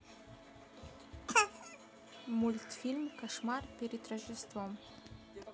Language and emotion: Russian, neutral